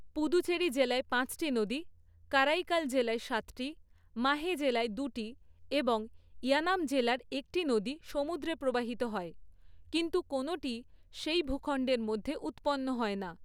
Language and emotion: Bengali, neutral